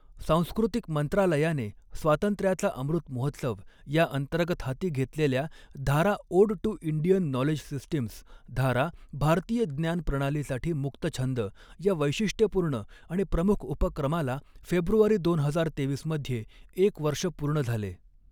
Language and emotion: Marathi, neutral